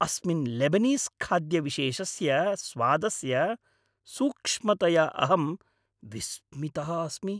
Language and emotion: Sanskrit, happy